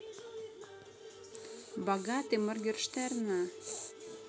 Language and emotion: Russian, neutral